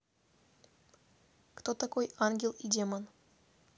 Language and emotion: Russian, neutral